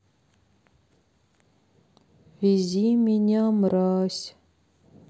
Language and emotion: Russian, sad